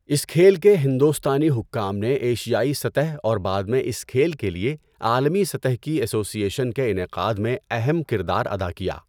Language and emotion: Urdu, neutral